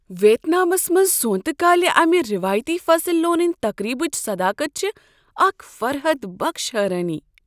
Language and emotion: Kashmiri, surprised